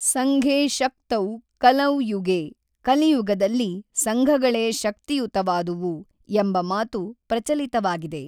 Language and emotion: Kannada, neutral